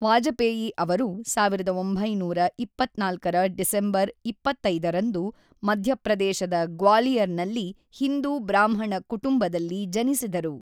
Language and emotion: Kannada, neutral